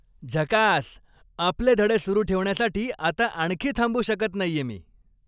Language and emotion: Marathi, happy